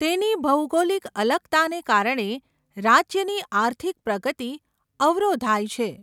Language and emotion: Gujarati, neutral